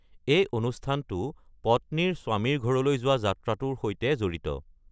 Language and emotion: Assamese, neutral